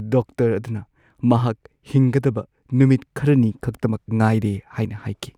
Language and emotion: Manipuri, sad